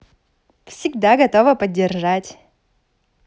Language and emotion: Russian, positive